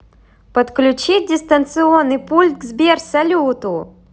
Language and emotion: Russian, positive